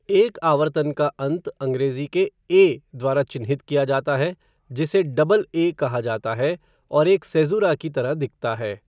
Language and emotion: Hindi, neutral